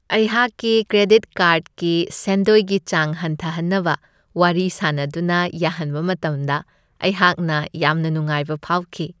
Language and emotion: Manipuri, happy